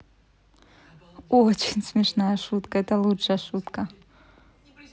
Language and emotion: Russian, positive